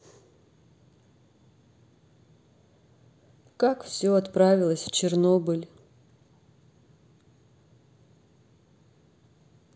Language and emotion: Russian, sad